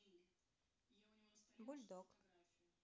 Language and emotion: Russian, neutral